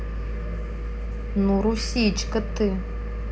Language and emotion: Russian, neutral